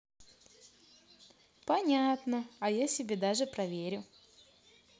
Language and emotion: Russian, positive